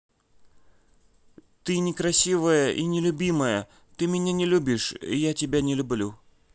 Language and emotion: Russian, neutral